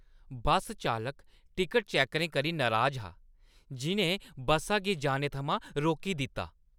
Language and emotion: Dogri, angry